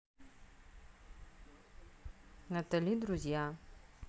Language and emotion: Russian, neutral